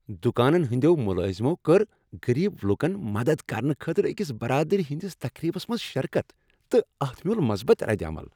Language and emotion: Kashmiri, happy